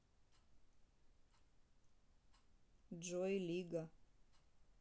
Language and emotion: Russian, neutral